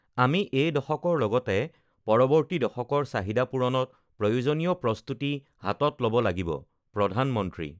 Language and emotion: Assamese, neutral